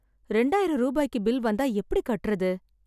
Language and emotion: Tamil, sad